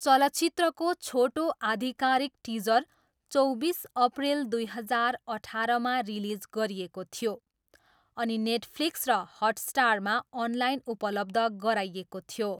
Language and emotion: Nepali, neutral